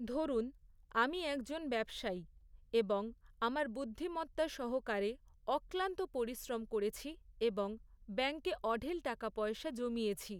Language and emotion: Bengali, neutral